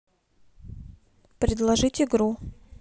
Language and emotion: Russian, neutral